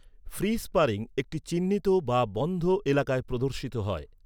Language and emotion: Bengali, neutral